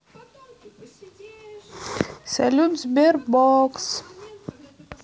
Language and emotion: Russian, neutral